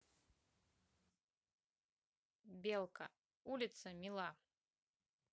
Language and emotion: Russian, neutral